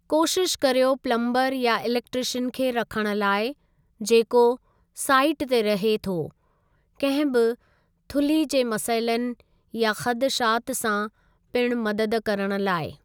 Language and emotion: Sindhi, neutral